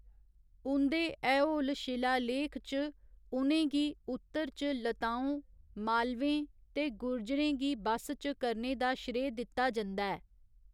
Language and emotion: Dogri, neutral